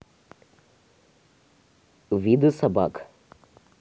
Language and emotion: Russian, neutral